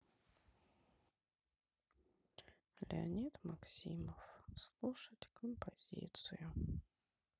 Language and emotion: Russian, sad